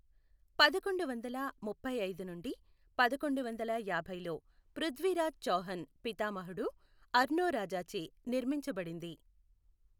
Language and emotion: Telugu, neutral